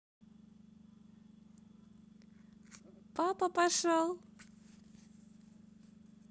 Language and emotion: Russian, positive